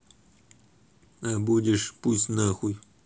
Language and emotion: Russian, neutral